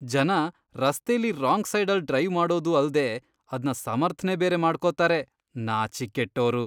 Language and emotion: Kannada, disgusted